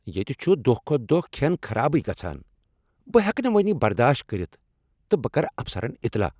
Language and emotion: Kashmiri, angry